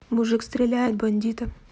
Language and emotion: Russian, neutral